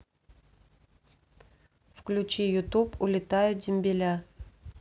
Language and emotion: Russian, neutral